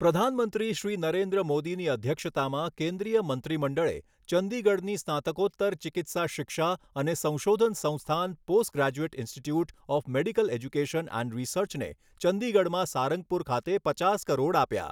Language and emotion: Gujarati, neutral